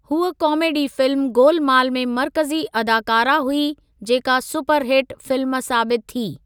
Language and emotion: Sindhi, neutral